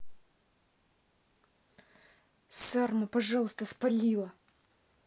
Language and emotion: Russian, angry